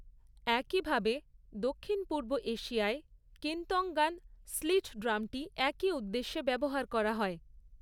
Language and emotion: Bengali, neutral